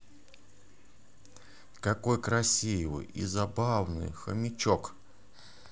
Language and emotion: Russian, positive